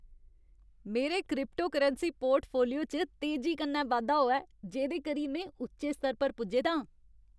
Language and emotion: Dogri, happy